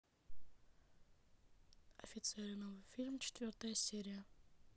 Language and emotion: Russian, neutral